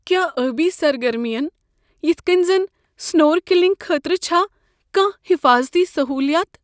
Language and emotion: Kashmiri, fearful